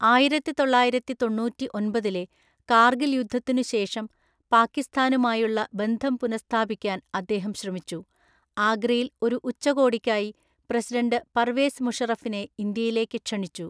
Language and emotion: Malayalam, neutral